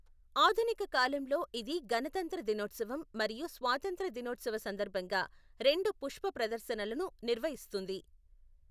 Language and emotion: Telugu, neutral